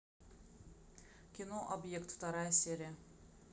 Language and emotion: Russian, neutral